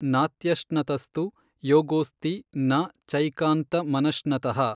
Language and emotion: Kannada, neutral